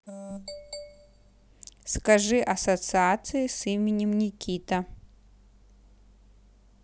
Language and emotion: Russian, neutral